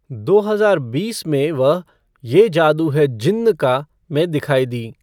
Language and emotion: Hindi, neutral